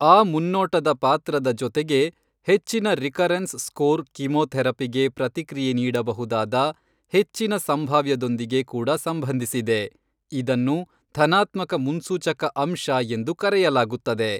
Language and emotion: Kannada, neutral